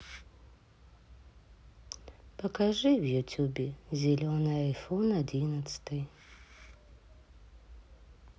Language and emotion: Russian, sad